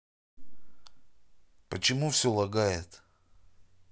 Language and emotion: Russian, neutral